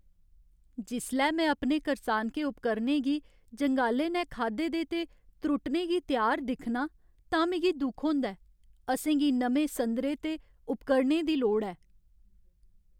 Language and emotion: Dogri, sad